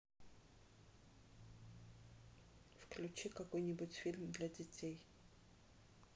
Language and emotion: Russian, neutral